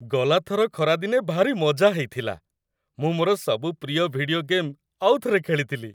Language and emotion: Odia, happy